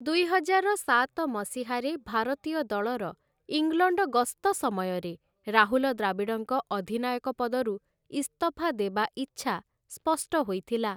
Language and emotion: Odia, neutral